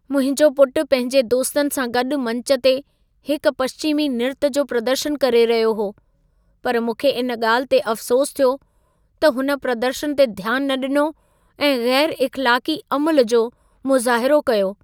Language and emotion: Sindhi, sad